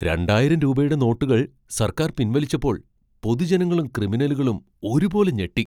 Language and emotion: Malayalam, surprised